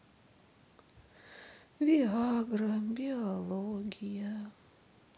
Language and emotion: Russian, sad